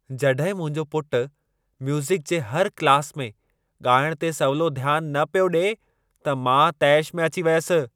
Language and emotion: Sindhi, angry